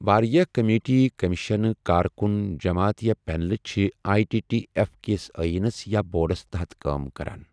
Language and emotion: Kashmiri, neutral